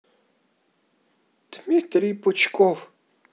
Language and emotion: Russian, neutral